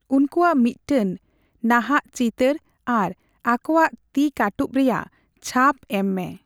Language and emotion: Santali, neutral